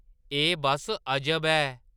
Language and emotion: Dogri, surprised